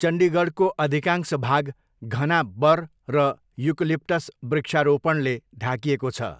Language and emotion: Nepali, neutral